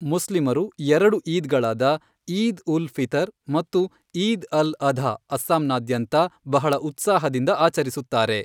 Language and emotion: Kannada, neutral